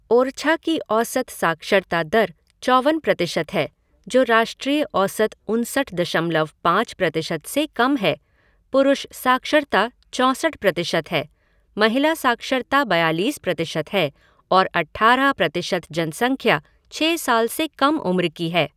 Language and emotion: Hindi, neutral